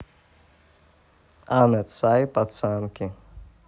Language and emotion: Russian, neutral